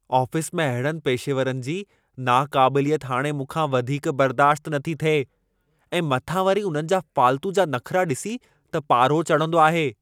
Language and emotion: Sindhi, angry